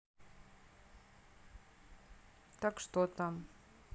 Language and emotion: Russian, neutral